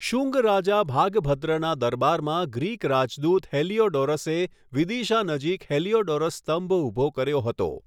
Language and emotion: Gujarati, neutral